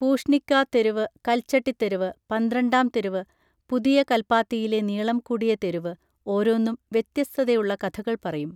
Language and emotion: Malayalam, neutral